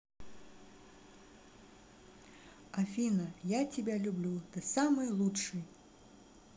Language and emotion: Russian, positive